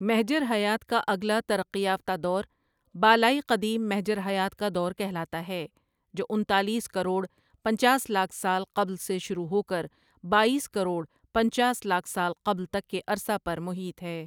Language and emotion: Urdu, neutral